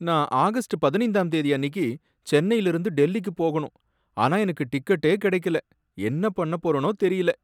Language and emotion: Tamil, sad